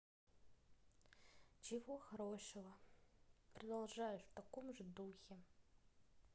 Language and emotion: Russian, neutral